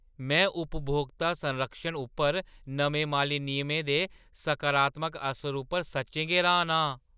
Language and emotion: Dogri, surprised